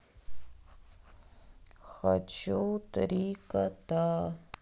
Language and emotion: Russian, sad